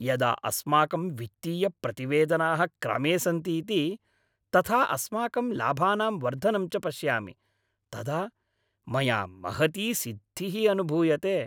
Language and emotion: Sanskrit, happy